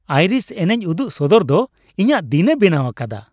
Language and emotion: Santali, happy